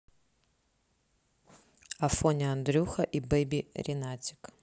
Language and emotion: Russian, neutral